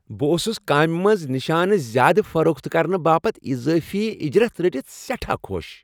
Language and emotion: Kashmiri, happy